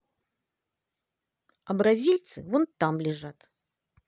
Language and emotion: Russian, positive